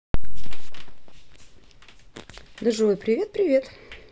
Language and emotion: Russian, positive